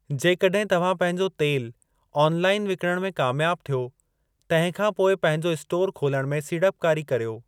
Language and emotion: Sindhi, neutral